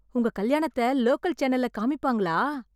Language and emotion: Tamil, surprised